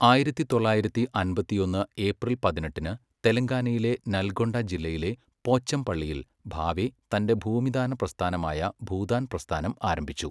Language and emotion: Malayalam, neutral